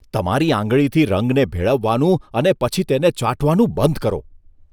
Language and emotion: Gujarati, disgusted